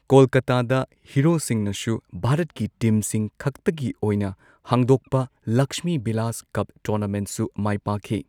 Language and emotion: Manipuri, neutral